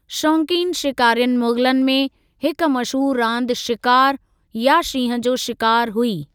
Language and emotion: Sindhi, neutral